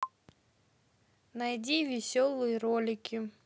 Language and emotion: Russian, neutral